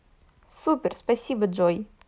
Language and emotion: Russian, positive